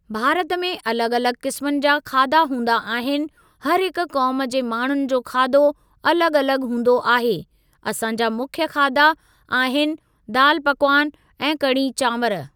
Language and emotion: Sindhi, neutral